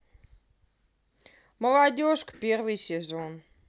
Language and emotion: Russian, neutral